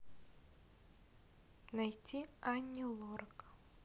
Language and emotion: Russian, neutral